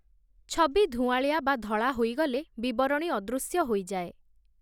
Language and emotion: Odia, neutral